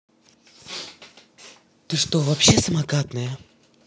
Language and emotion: Russian, angry